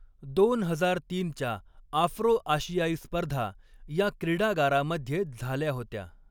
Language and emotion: Marathi, neutral